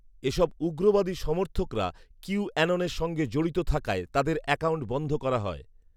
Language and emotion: Bengali, neutral